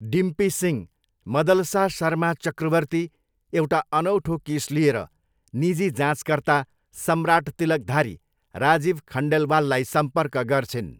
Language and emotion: Nepali, neutral